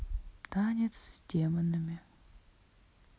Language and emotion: Russian, sad